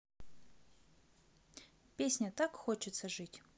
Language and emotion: Russian, neutral